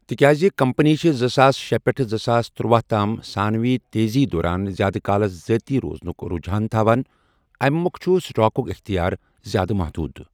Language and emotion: Kashmiri, neutral